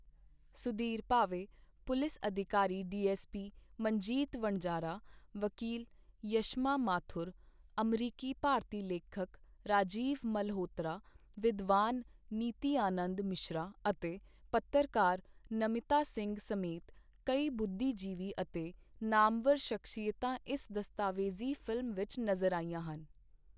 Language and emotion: Punjabi, neutral